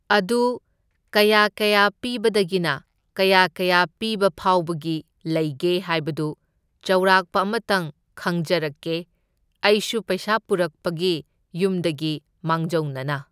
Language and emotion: Manipuri, neutral